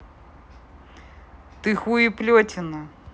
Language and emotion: Russian, angry